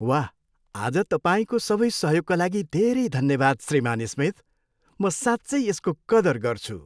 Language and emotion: Nepali, happy